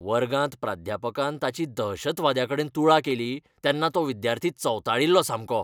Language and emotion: Goan Konkani, angry